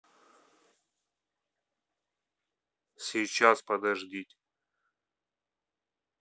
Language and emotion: Russian, neutral